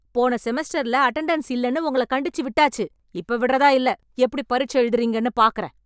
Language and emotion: Tamil, angry